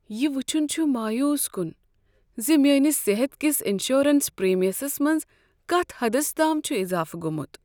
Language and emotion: Kashmiri, sad